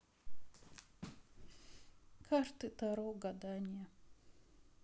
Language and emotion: Russian, sad